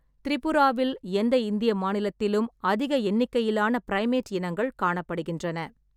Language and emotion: Tamil, neutral